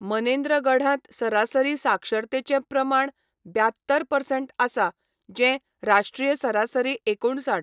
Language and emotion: Goan Konkani, neutral